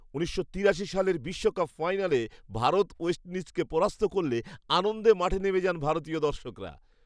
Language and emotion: Bengali, happy